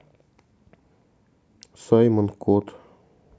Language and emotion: Russian, neutral